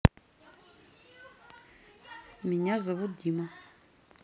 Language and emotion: Russian, neutral